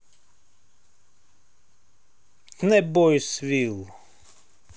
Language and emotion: Russian, neutral